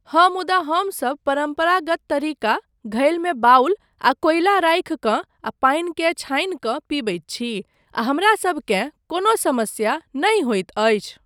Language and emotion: Maithili, neutral